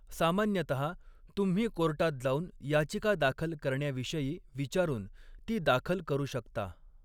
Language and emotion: Marathi, neutral